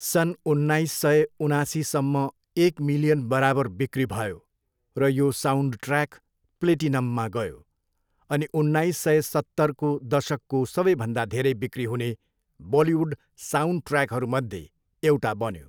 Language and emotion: Nepali, neutral